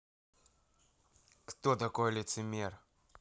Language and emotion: Russian, angry